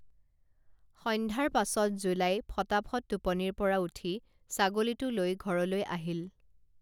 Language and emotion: Assamese, neutral